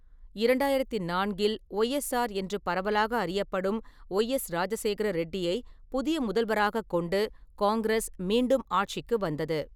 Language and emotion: Tamil, neutral